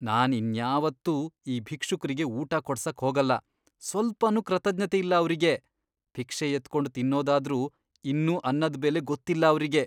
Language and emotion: Kannada, disgusted